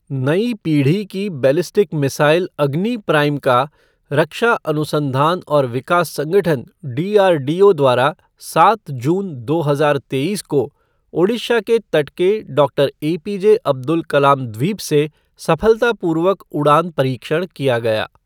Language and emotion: Hindi, neutral